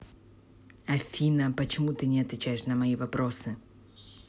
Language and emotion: Russian, angry